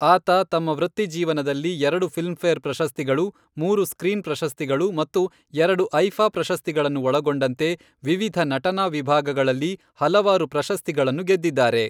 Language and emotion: Kannada, neutral